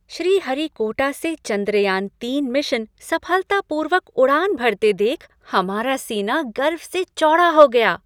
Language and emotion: Hindi, happy